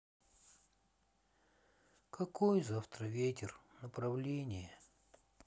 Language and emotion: Russian, sad